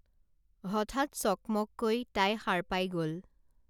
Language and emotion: Assamese, neutral